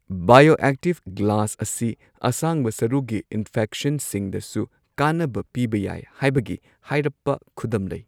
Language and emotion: Manipuri, neutral